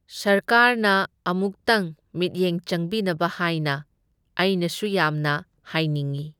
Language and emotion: Manipuri, neutral